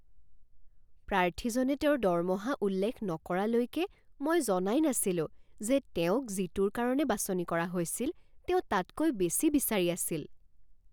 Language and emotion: Assamese, surprised